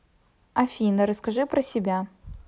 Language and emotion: Russian, neutral